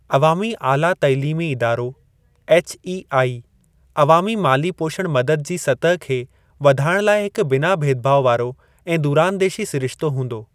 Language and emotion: Sindhi, neutral